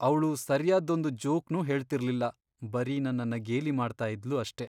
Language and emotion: Kannada, sad